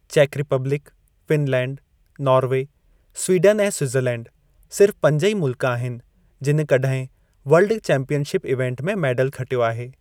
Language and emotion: Sindhi, neutral